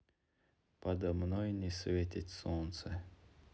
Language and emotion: Russian, sad